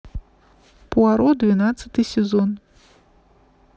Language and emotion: Russian, neutral